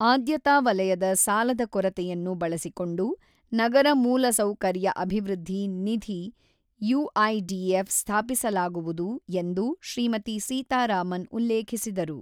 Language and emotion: Kannada, neutral